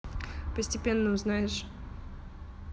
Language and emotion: Russian, neutral